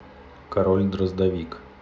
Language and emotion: Russian, neutral